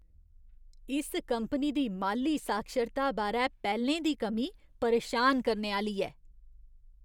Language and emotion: Dogri, disgusted